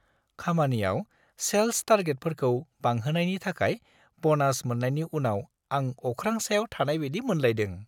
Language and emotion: Bodo, happy